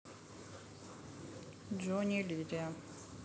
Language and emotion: Russian, neutral